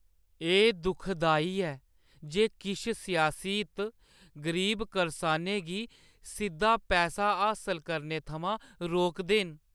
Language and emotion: Dogri, sad